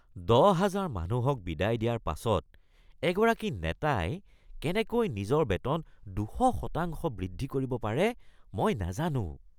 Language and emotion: Assamese, disgusted